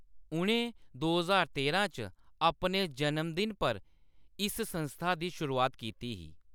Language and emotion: Dogri, neutral